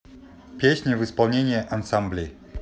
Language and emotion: Russian, neutral